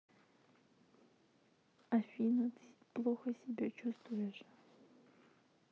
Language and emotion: Russian, sad